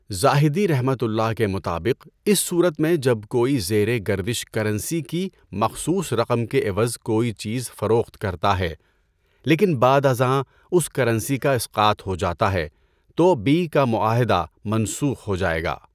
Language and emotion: Urdu, neutral